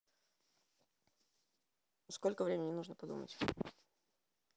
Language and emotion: Russian, neutral